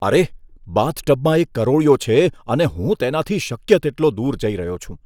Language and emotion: Gujarati, disgusted